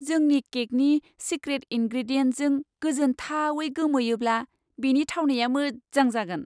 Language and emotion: Bodo, surprised